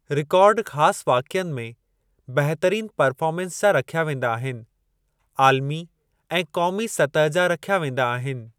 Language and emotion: Sindhi, neutral